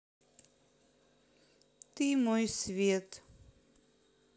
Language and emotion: Russian, sad